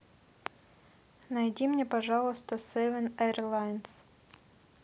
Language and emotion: Russian, neutral